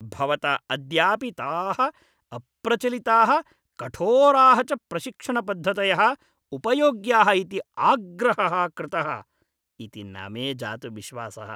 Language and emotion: Sanskrit, disgusted